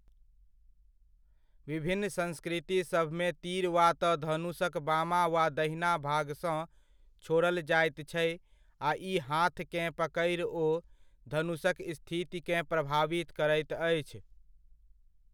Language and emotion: Maithili, neutral